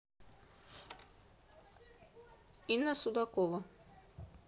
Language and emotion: Russian, neutral